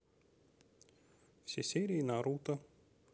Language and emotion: Russian, neutral